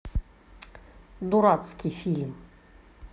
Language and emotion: Russian, angry